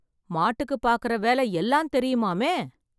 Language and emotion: Tamil, surprised